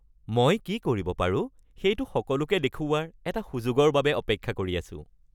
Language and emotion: Assamese, happy